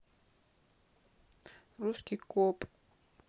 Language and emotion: Russian, neutral